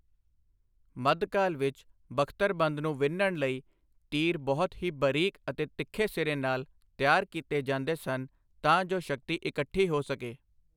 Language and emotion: Punjabi, neutral